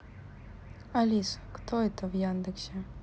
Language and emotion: Russian, neutral